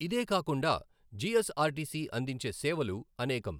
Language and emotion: Telugu, neutral